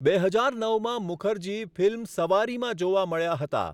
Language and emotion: Gujarati, neutral